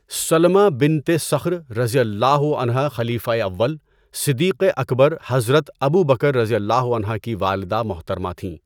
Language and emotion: Urdu, neutral